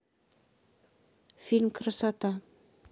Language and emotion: Russian, neutral